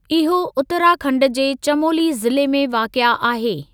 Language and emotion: Sindhi, neutral